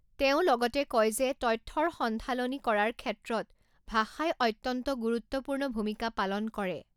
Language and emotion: Assamese, neutral